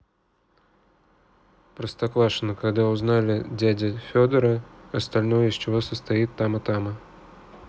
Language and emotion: Russian, neutral